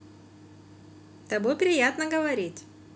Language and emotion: Russian, positive